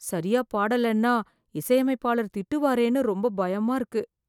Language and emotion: Tamil, fearful